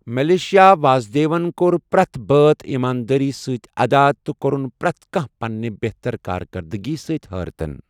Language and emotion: Kashmiri, neutral